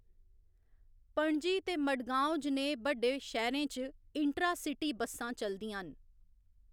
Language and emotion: Dogri, neutral